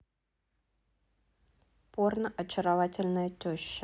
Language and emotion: Russian, neutral